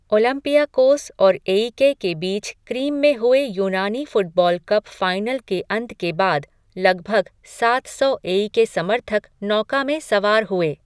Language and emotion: Hindi, neutral